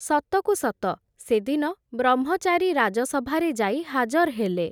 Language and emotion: Odia, neutral